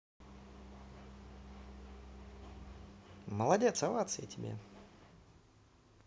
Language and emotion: Russian, positive